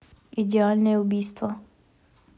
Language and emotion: Russian, neutral